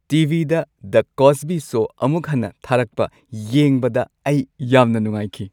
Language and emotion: Manipuri, happy